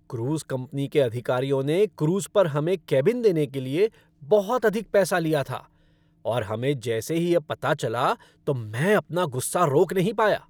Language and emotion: Hindi, angry